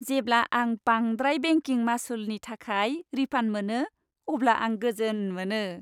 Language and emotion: Bodo, happy